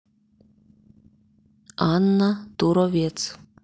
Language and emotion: Russian, neutral